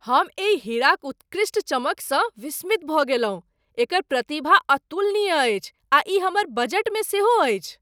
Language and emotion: Maithili, surprised